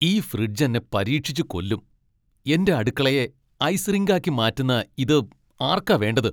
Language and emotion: Malayalam, angry